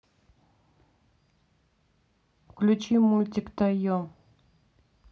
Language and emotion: Russian, neutral